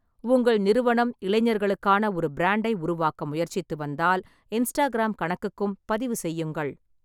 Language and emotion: Tamil, neutral